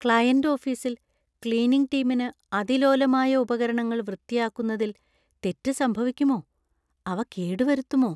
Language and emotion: Malayalam, fearful